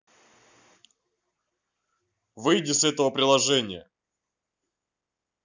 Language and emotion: Russian, angry